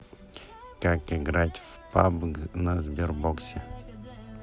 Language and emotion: Russian, neutral